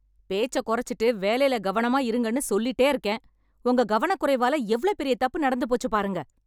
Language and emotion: Tamil, angry